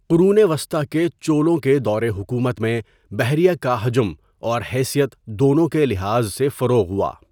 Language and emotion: Urdu, neutral